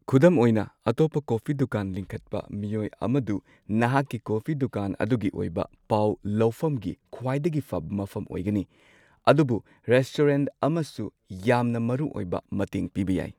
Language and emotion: Manipuri, neutral